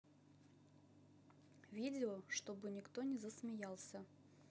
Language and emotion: Russian, neutral